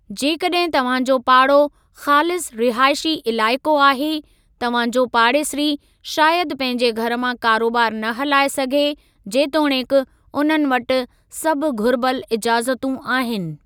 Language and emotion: Sindhi, neutral